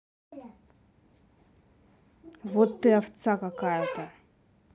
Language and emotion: Russian, angry